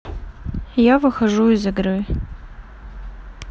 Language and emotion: Russian, neutral